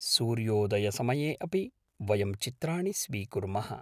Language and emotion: Sanskrit, neutral